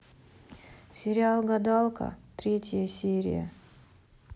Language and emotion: Russian, sad